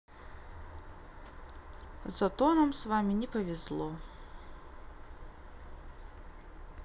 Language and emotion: Russian, sad